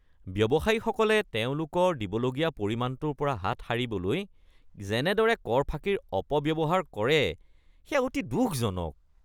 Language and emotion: Assamese, disgusted